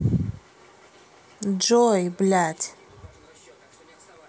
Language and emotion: Russian, angry